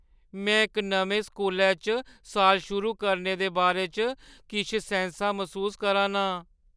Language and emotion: Dogri, fearful